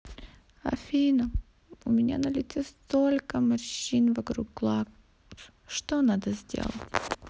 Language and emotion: Russian, sad